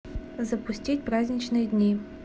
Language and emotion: Russian, neutral